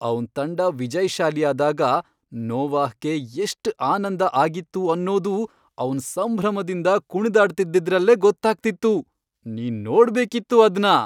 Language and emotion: Kannada, happy